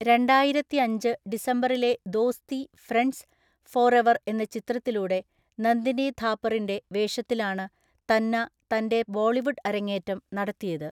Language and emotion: Malayalam, neutral